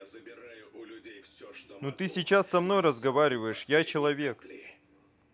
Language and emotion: Russian, angry